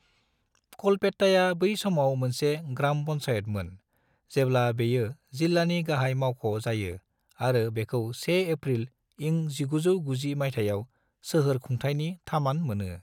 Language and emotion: Bodo, neutral